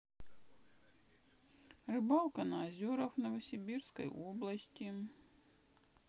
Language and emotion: Russian, sad